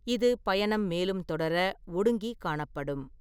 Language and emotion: Tamil, neutral